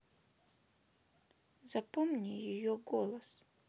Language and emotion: Russian, sad